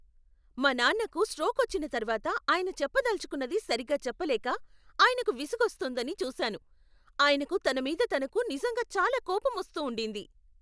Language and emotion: Telugu, angry